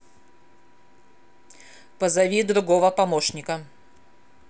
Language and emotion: Russian, angry